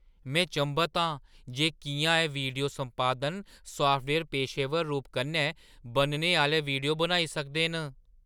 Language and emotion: Dogri, surprised